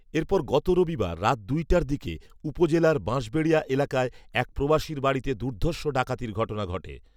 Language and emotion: Bengali, neutral